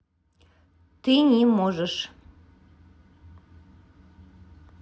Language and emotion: Russian, neutral